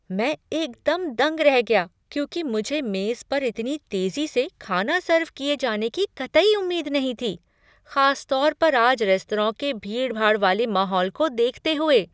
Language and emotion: Hindi, surprised